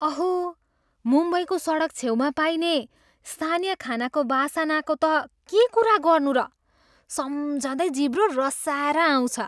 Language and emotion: Nepali, surprised